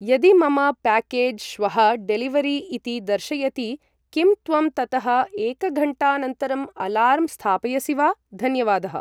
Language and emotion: Sanskrit, neutral